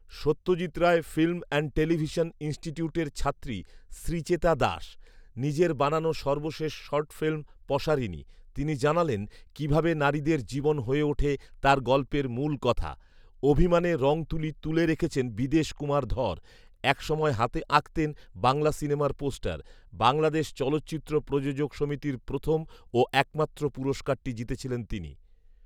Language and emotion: Bengali, neutral